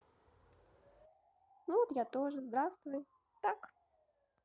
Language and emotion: Russian, positive